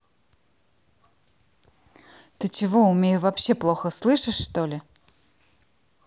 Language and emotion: Russian, neutral